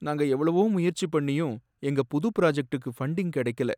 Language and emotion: Tamil, sad